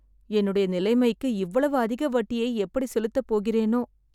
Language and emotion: Tamil, sad